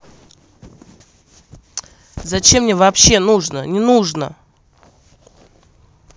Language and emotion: Russian, angry